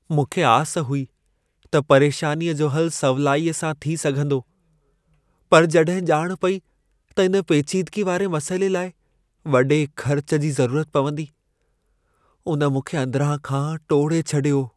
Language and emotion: Sindhi, sad